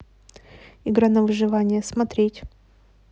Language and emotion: Russian, neutral